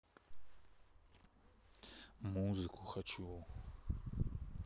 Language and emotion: Russian, neutral